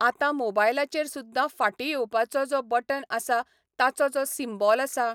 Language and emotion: Goan Konkani, neutral